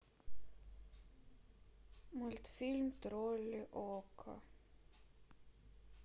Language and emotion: Russian, sad